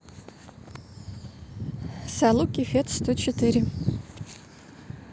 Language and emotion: Russian, neutral